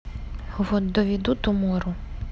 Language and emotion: Russian, neutral